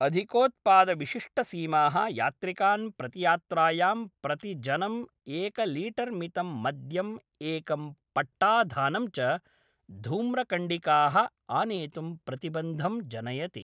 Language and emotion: Sanskrit, neutral